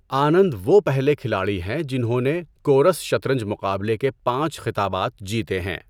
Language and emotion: Urdu, neutral